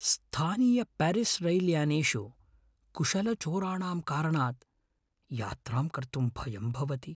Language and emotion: Sanskrit, fearful